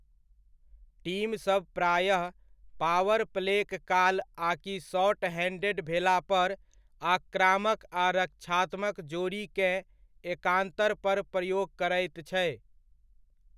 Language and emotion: Maithili, neutral